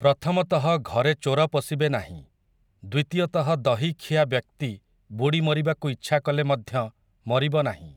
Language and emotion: Odia, neutral